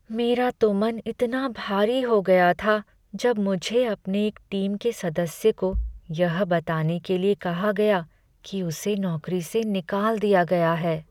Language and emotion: Hindi, sad